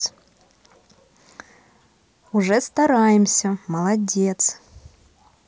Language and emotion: Russian, positive